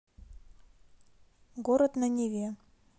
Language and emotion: Russian, neutral